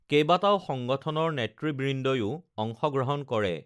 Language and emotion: Assamese, neutral